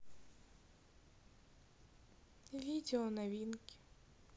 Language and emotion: Russian, sad